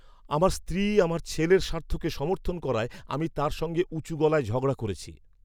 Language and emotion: Bengali, angry